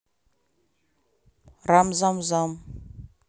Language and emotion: Russian, neutral